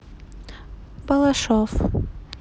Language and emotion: Russian, neutral